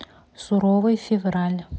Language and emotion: Russian, neutral